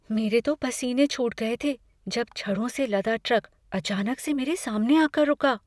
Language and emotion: Hindi, fearful